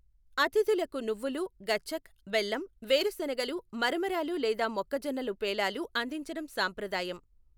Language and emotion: Telugu, neutral